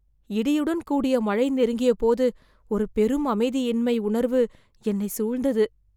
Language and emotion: Tamil, fearful